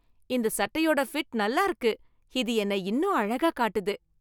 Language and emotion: Tamil, happy